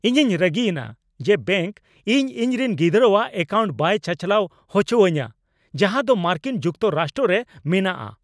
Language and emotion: Santali, angry